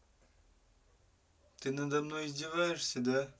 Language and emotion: Russian, neutral